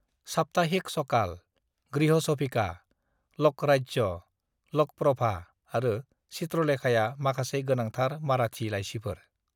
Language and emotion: Bodo, neutral